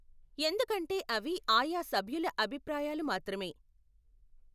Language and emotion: Telugu, neutral